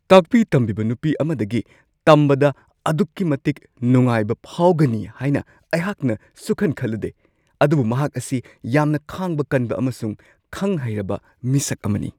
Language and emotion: Manipuri, surprised